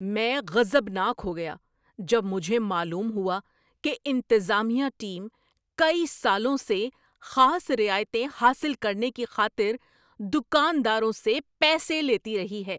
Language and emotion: Urdu, angry